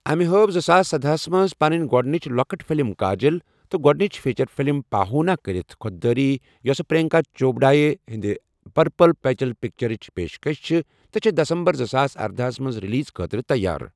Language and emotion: Kashmiri, neutral